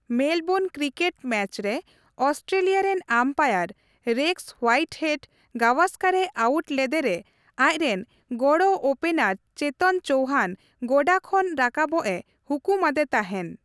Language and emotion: Santali, neutral